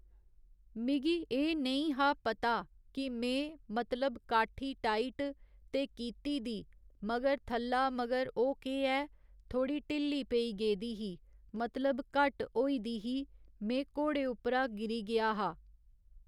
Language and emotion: Dogri, neutral